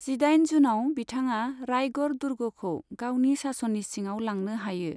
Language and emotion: Bodo, neutral